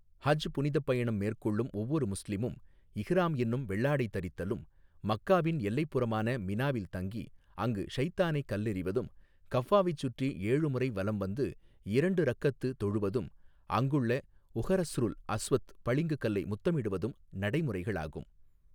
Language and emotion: Tamil, neutral